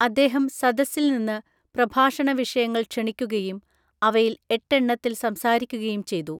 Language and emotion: Malayalam, neutral